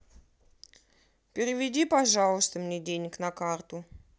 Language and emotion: Russian, neutral